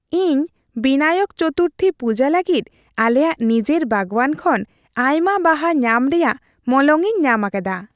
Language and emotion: Santali, happy